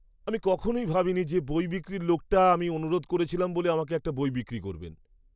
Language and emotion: Bengali, surprised